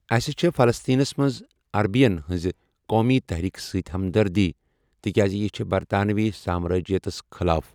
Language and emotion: Kashmiri, neutral